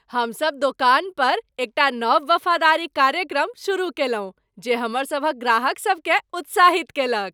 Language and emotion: Maithili, happy